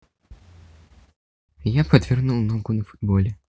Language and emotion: Russian, neutral